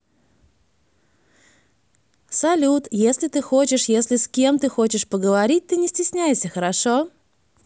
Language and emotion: Russian, positive